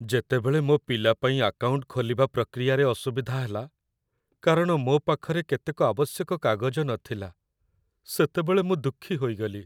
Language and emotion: Odia, sad